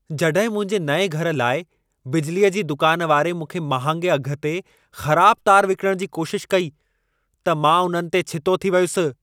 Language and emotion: Sindhi, angry